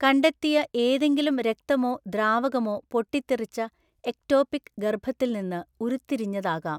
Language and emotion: Malayalam, neutral